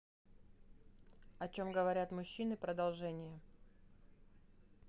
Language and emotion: Russian, neutral